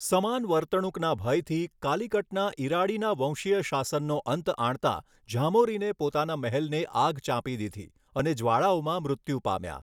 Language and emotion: Gujarati, neutral